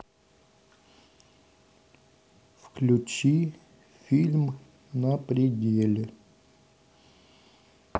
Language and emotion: Russian, neutral